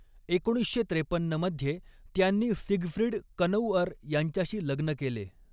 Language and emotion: Marathi, neutral